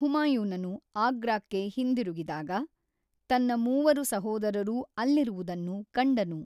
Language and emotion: Kannada, neutral